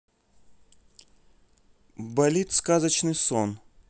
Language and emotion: Russian, neutral